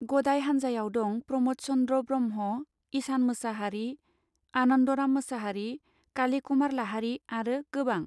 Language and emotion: Bodo, neutral